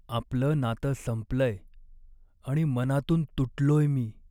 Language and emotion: Marathi, sad